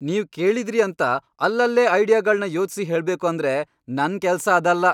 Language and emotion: Kannada, angry